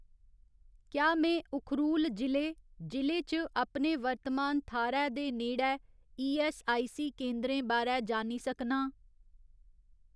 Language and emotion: Dogri, neutral